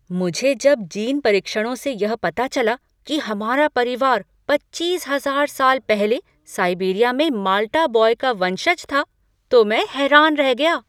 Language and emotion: Hindi, surprised